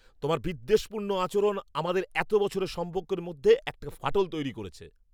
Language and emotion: Bengali, angry